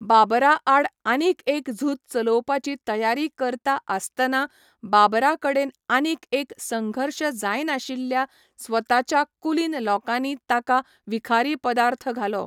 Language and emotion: Goan Konkani, neutral